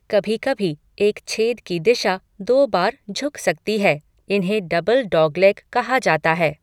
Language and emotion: Hindi, neutral